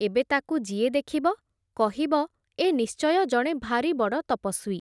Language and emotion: Odia, neutral